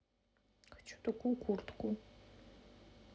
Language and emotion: Russian, sad